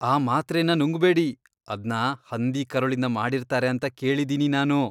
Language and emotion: Kannada, disgusted